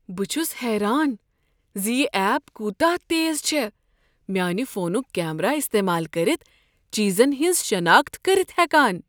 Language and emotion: Kashmiri, surprised